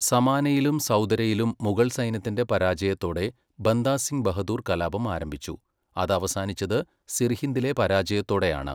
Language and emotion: Malayalam, neutral